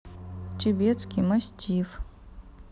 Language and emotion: Russian, neutral